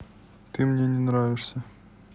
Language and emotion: Russian, neutral